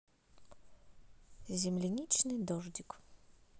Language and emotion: Russian, neutral